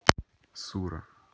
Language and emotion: Russian, neutral